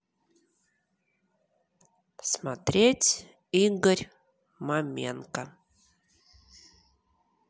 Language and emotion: Russian, neutral